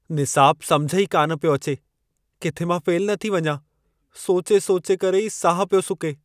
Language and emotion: Sindhi, fearful